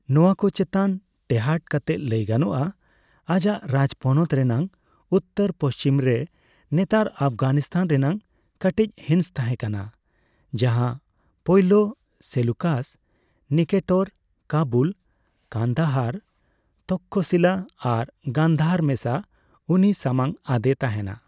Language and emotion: Santali, neutral